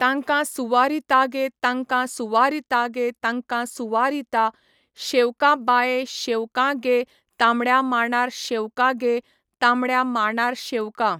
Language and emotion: Goan Konkani, neutral